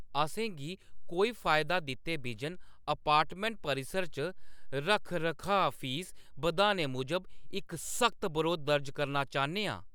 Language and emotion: Dogri, angry